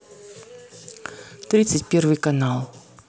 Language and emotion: Russian, neutral